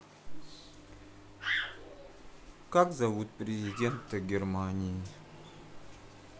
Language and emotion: Russian, neutral